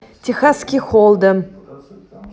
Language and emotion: Russian, neutral